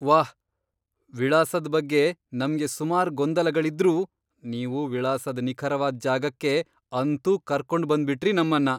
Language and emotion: Kannada, surprised